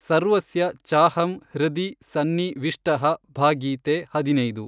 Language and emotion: Kannada, neutral